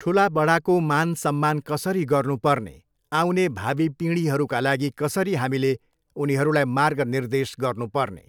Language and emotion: Nepali, neutral